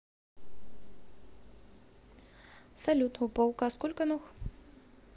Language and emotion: Russian, neutral